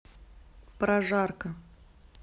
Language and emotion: Russian, neutral